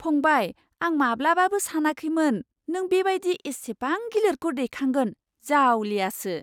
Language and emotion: Bodo, surprised